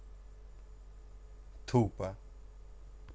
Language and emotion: Russian, neutral